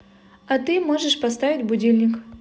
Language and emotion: Russian, positive